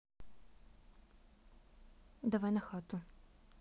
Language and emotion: Russian, neutral